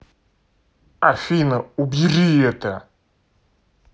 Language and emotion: Russian, angry